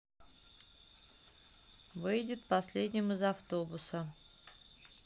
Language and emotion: Russian, neutral